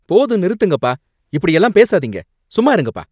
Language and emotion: Tamil, angry